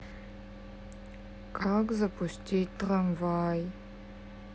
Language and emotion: Russian, sad